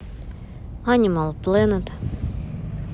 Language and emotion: Russian, neutral